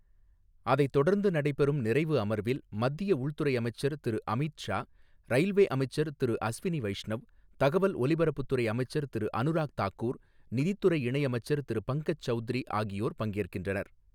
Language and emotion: Tamil, neutral